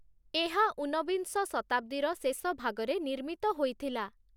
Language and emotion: Odia, neutral